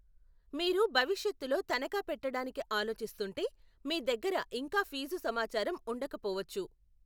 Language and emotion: Telugu, neutral